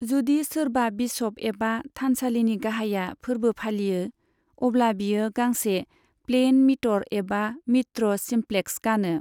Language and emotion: Bodo, neutral